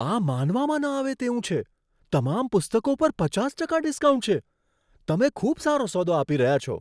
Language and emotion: Gujarati, surprised